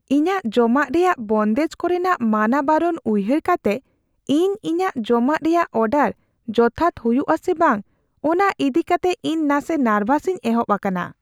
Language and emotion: Santali, fearful